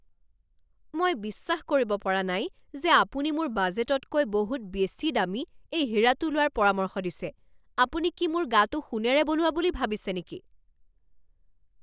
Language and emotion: Assamese, angry